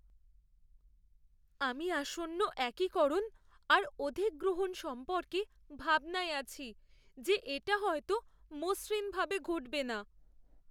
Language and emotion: Bengali, fearful